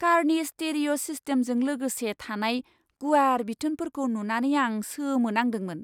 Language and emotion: Bodo, surprised